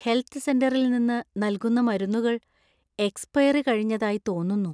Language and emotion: Malayalam, fearful